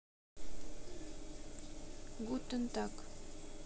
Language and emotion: Russian, neutral